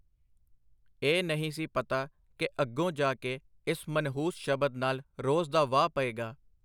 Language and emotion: Punjabi, neutral